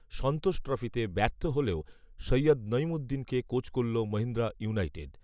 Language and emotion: Bengali, neutral